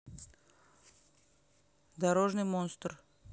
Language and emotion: Russian, neutral